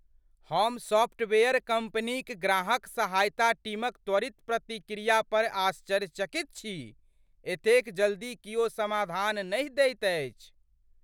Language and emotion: Maithili, surprised